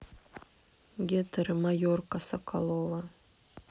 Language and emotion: Russian, neutral